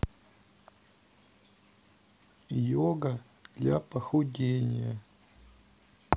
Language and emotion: Russian, sad